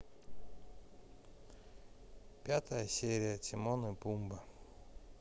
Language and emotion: Russian, neutral